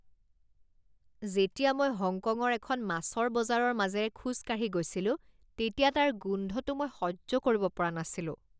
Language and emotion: Assamese, disgusted